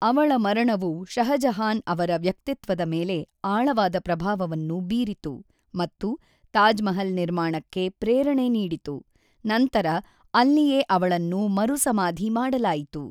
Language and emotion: Kannada, neutral